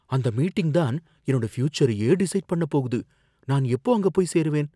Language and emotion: Tamil, fearful